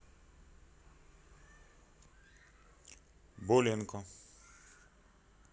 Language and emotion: Russian, neutral